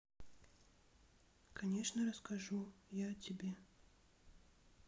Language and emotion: Russian, neutral